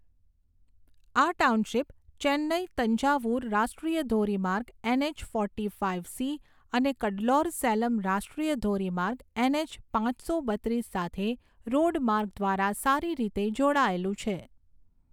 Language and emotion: Gujarati, neutral